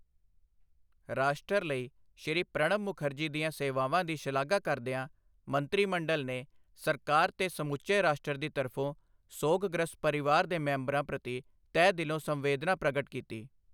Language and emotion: Punjabi, neutral